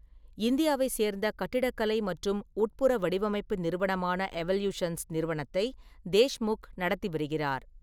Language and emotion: Tamil, neutral